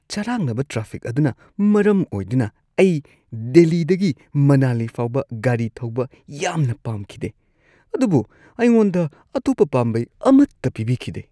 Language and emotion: Manipuri, disgusted